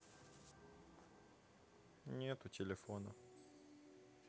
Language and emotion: Russian, sad